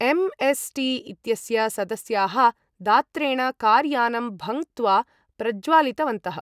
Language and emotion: Sanskrit, neutral